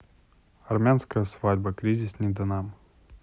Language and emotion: Russian, neutral